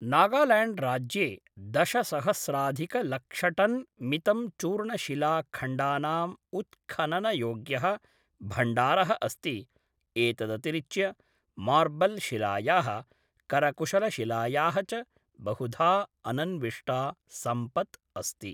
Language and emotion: Sanskrit, neutral